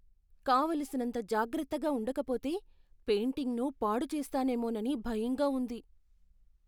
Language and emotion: Telugu, fearful